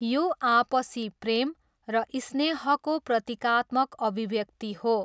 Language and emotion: Nepali, neutral